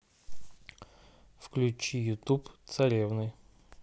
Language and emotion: Russian, neutral